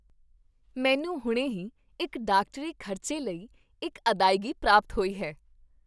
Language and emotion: Punjabi, happy